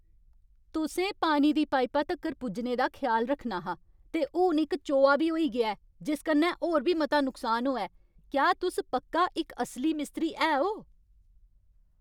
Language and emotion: Dogri, angry